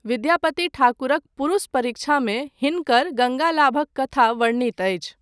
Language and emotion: Maithili, neutral